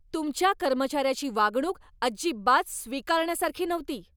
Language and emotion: Marathi, angry